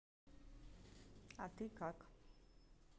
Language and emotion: Russian, neutral